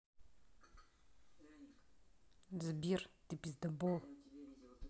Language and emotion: Russian, angry